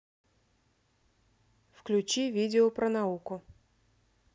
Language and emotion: Russian, neutral